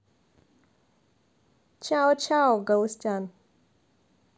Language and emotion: Russian, neutral